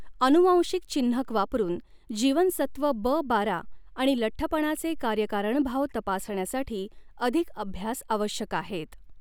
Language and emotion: Marathi, neutral